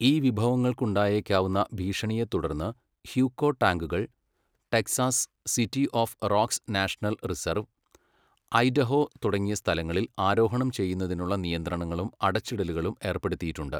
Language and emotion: Malayalam, neutral